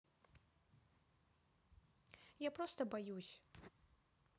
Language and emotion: Russian, neutral